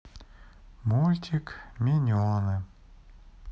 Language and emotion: Russian, sad